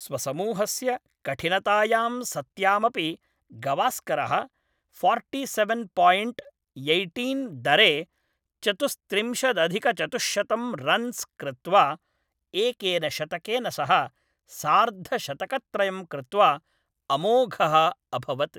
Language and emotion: Sanskrit, neutral